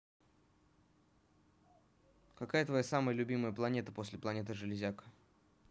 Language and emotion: Russian, neutral